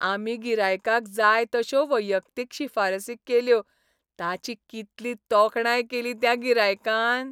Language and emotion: Goan Konkani, happy